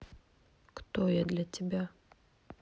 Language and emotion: Russian, neutral